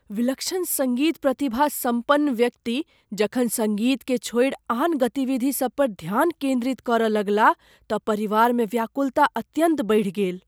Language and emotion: Maithili, fearful